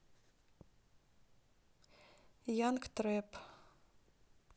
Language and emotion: Russian, neutral